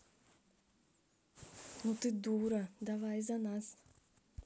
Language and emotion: Russian, neutral